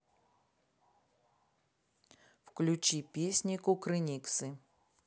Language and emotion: Russian, neutral